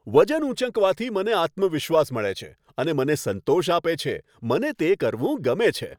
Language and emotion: Gujarati, happy